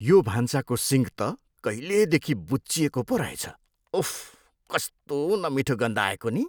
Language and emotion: Nepali, disgusted